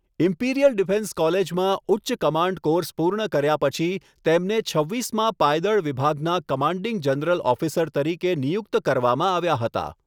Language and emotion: Gujarati, neutral